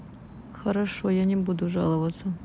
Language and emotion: Russian, neutral